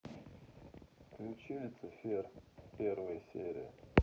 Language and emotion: Russian, sad